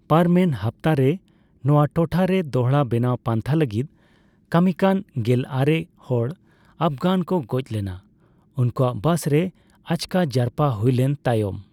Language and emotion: Santali, neutral